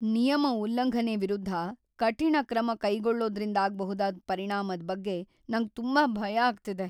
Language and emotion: Kannada, fearful